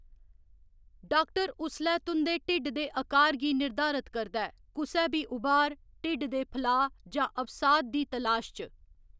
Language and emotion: Dogri, neutral